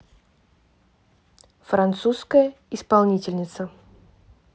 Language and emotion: Russian, neutral